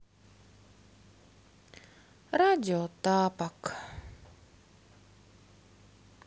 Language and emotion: Russian, sad